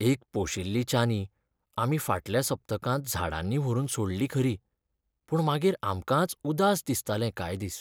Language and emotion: Goan Konkani, sad